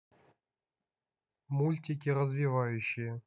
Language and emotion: Russian, neutral